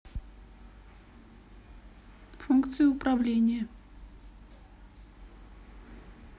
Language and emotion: Russian, neutral